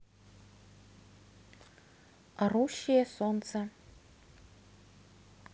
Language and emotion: Russian, neutral